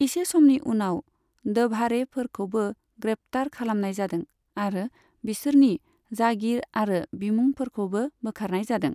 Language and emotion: Bodo, neutral